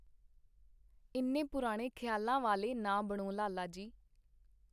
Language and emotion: Punjabi, neutral